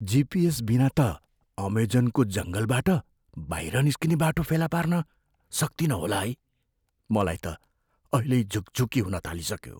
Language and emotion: Nepali, fearful